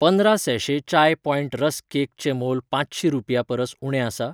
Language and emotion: Goan Konkani, neutral